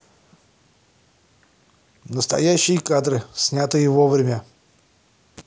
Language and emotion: Russian, positive